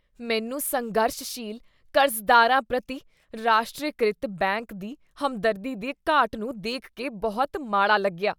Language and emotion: Punjabi, disgusted